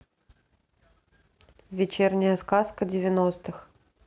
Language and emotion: Russian, neutral